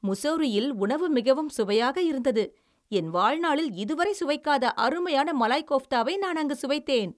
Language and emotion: Tamil, happy